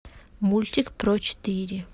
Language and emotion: Russian, neutral